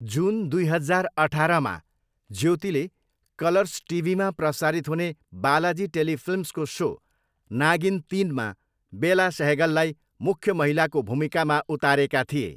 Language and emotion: Nepali, neutral